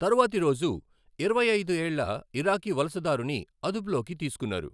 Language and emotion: Telugu, neutral